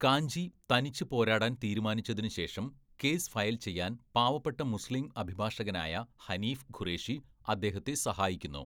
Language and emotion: Malayalam, neutral